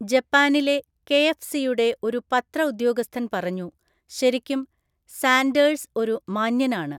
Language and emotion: Malayalam, neutral